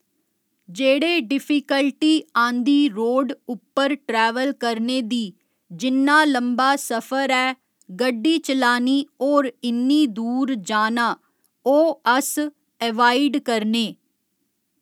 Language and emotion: Dogri, neutral